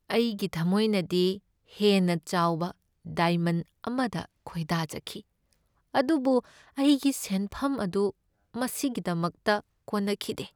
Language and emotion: Manipuri, sad